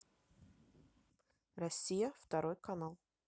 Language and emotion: Russian, neutral